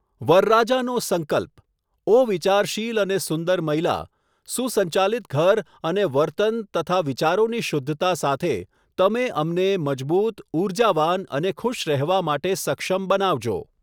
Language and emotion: Gujarati, neutral